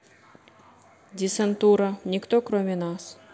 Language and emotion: Russian, neutral